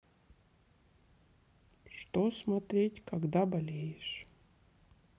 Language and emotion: Russian, sad